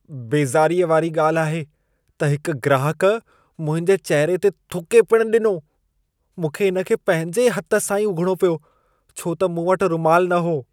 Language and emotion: Sindhi, disgusted